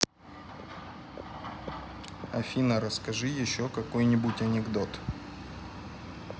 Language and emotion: Russian, neutral